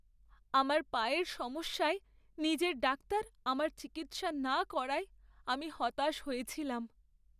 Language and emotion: Bengali, sad